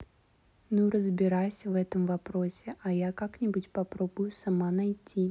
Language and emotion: Russian, neutral